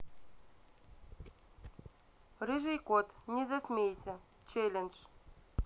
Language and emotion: Russian, neutral